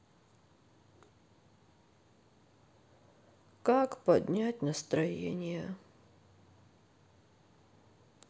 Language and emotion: Russian, sad